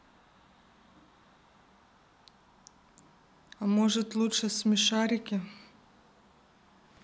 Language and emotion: Russian, neutral